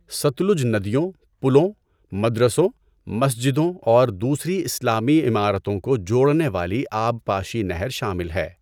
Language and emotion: Urdu, neutral